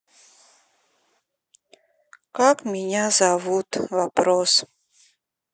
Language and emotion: Russian, sad